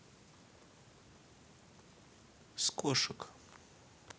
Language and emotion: Russian, neutral